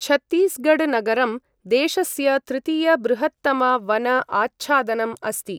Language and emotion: Sanskrit, neutral